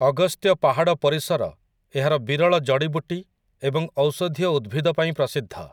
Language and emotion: Odia, neutral